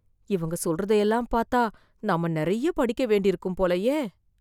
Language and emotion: Tamil, fearful